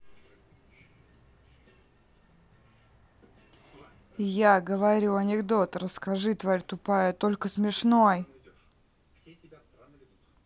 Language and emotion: Russian, angry